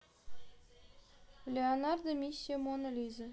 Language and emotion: Russian, neutral